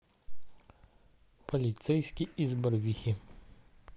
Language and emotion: Russian, neutral